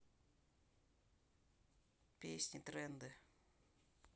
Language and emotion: Russian, neutral